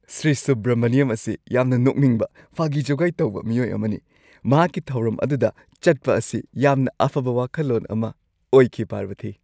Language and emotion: Manipuri, happy